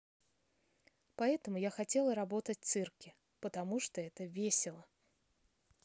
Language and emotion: Russian, neutral